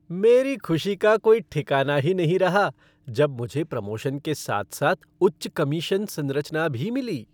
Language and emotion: Hindi, happy